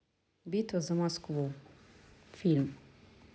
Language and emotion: Russian, neutral